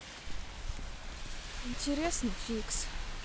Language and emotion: Russian, sad